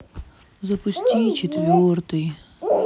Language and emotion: Russian, sad